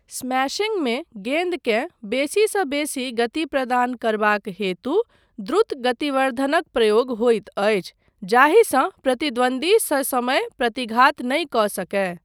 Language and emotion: Maithili, neutral